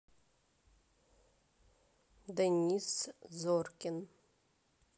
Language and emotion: Russian, neutral